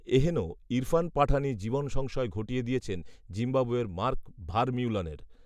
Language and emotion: Bengali, neutral